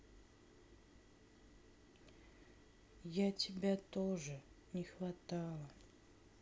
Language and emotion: Russian, sad